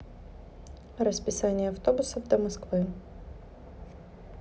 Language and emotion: Russian, neutral